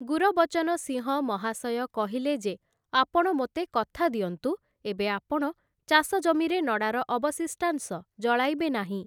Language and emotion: Odia, neutral